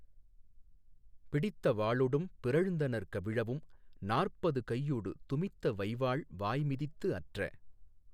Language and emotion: Tamil, neutral